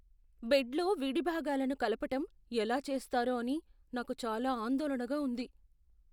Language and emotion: Telugu, fearful